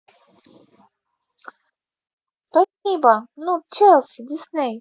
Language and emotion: Russian, positive